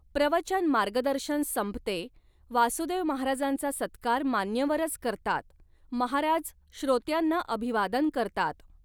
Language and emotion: Marathi, neutral